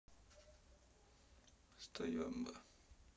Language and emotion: Russian, sad